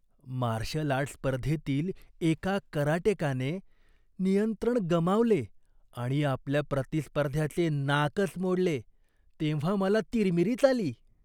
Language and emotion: Marathi, disgusted